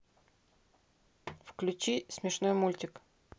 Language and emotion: Russian, neutral